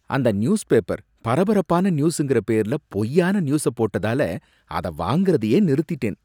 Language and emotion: Tamil, disgusted